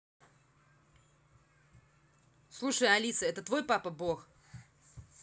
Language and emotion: Russian, angry